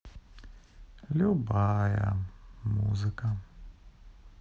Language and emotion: Russian, sad